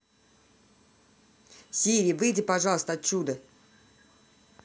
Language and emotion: Russian, angry